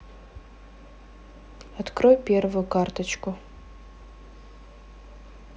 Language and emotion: Russian, neutral